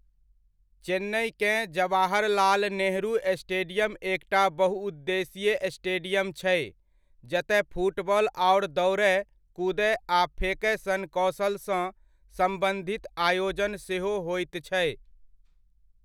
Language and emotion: Maithili, neutral